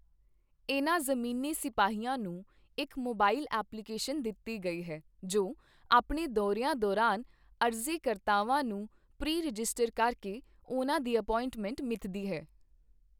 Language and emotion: Punjabi, neutral